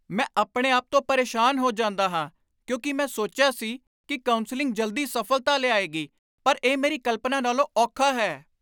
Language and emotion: Punjabi, angry